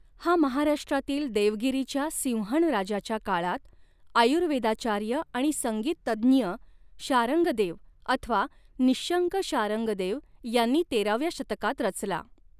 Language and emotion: Marathi, neutral